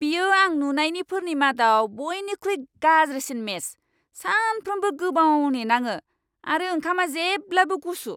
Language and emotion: Bodo, angry